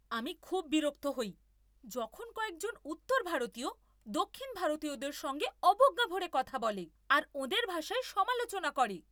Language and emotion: Bengali, angry